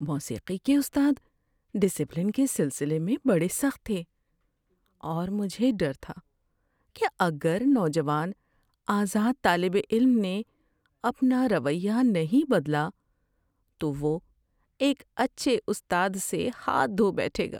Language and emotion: Urdu, fearful